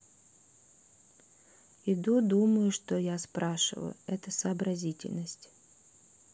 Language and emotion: Russian, sad